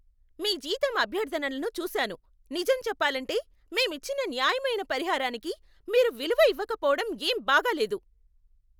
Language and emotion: Telugu, angry